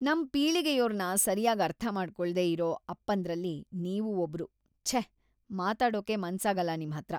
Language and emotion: Kannada, disgusted